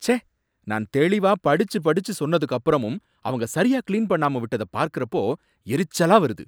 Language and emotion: Tamil, angry